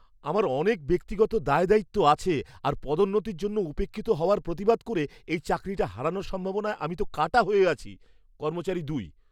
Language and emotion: Bengali, fearful